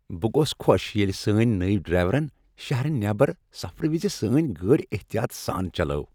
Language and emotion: Kashmiri, happy